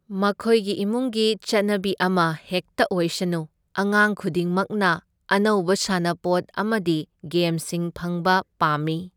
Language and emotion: Manipuri, neutral